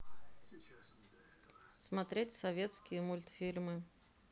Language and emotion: Russian, neutral